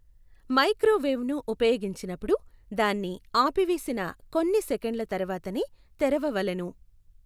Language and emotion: Telugu, neutral